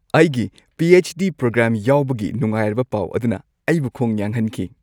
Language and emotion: Manipuri, happy